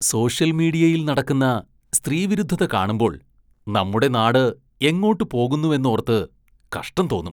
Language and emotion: Malayalam, disgusted